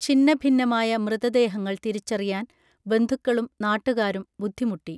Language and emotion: Malayalam, neutral